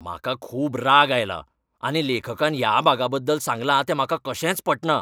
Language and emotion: Goan Konkani, angry